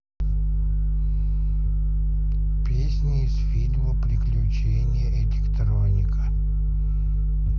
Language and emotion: Russian, neutral